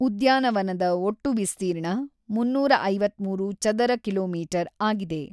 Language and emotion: Kannada, neutral